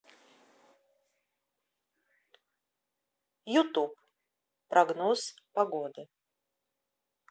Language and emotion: Russian, neutral